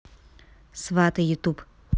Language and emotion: Russian, neutral